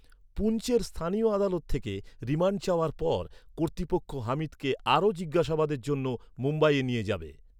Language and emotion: Bengali, neutral